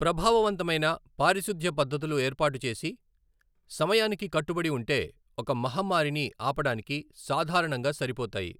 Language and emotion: Telugu, neutral